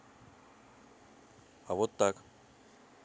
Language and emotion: Russian, neutral